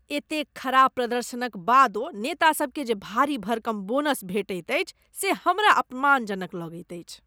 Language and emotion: Maithili, disgusted